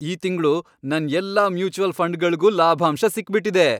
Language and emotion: Kannada, happy